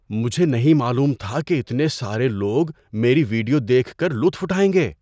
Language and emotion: Urdu, surprised